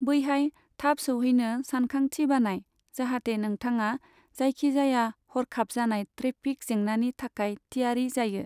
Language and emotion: Bodo, neutral